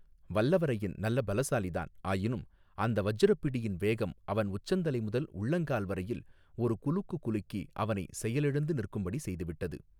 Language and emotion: Tamil, neutral